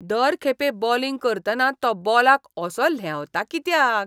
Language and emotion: Goan Konkani, disgusted